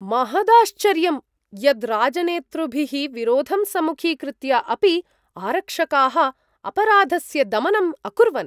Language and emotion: Sanskrit, surprised